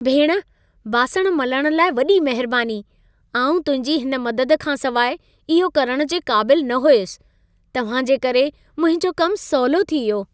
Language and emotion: Sindhi, happy